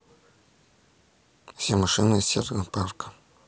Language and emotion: Russian, neutral